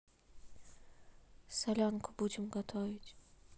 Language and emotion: Russian, neutral